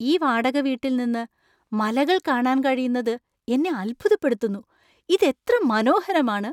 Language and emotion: Malayalam, surprised